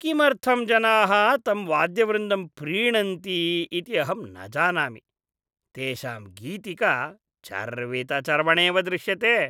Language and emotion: Sanskrit, disgusted